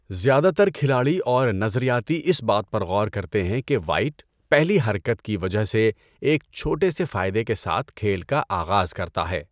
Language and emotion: Urdu, neutral